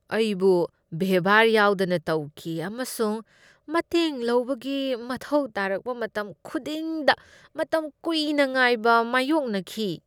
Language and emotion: Manipuri, disgusted